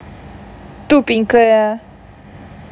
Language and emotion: Russian, angry